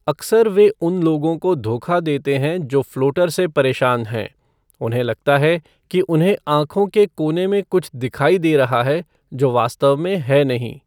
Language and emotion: Hindi, neutral